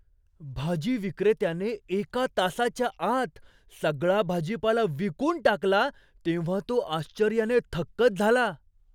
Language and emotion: Marathi, surprised